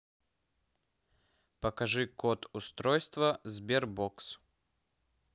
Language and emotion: Russian, neutral